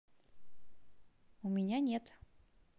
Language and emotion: Russian, neutral